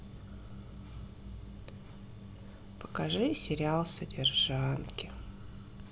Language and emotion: Russian, sad